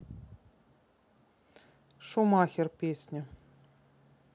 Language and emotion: Russian, neutral